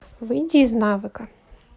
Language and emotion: Russian, neutral